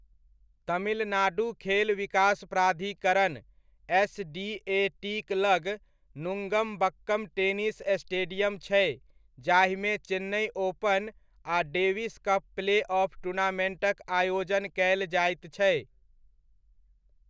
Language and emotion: Maithili, neutral